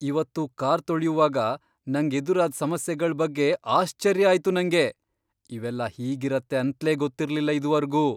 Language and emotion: Kannada, surprised